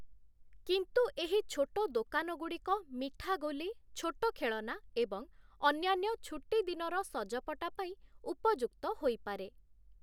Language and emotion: Odia, neutral